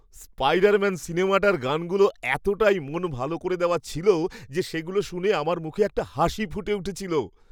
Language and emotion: Bengali, happy